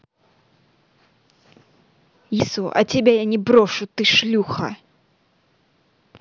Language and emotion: Russian, angry